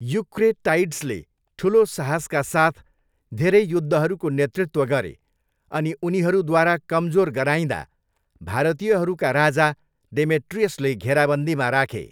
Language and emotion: Nepali, neutral